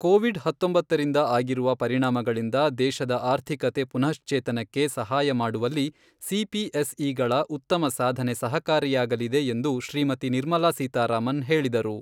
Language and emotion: Kannada, neutral